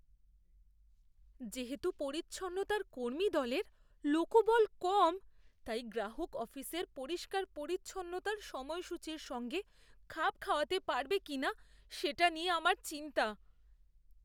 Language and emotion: Bengali, fearful